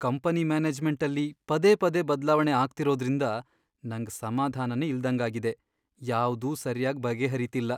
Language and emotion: Kannada, sad